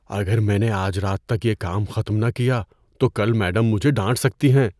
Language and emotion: Urdu, fearful